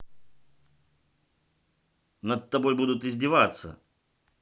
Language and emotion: Russian, neutral